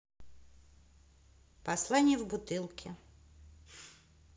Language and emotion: Russian, neutral